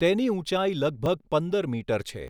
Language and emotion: Gujarati, neutral